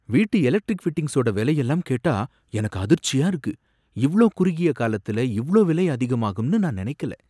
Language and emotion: Tamil, surprised